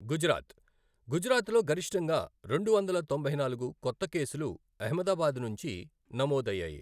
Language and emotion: Telugu, neutral